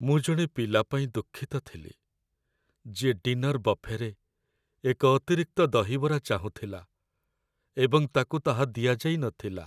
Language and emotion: Odia, sad